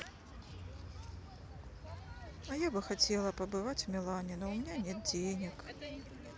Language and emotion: Russian, sad